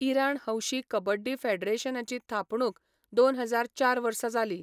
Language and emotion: Goan Konkani, neutral